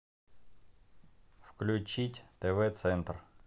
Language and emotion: Russian, neutral